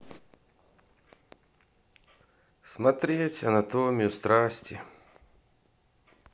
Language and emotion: Russian, sad